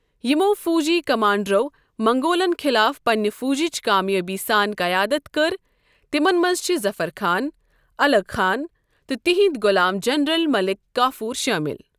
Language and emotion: Kashmiri, neutral